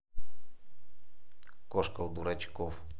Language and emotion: Russian, neutral